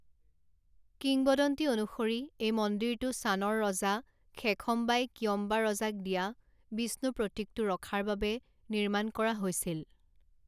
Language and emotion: Assamese, neutral